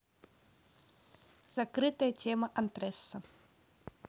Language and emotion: Russian, neutral